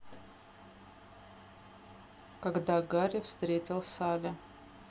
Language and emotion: Russian, neutral